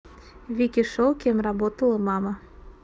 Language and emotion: Russian, neutral